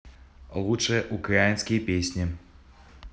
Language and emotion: Russian, neutral